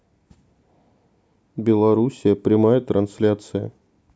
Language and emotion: Russian, neutral